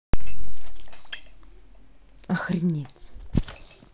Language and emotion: Russian, angry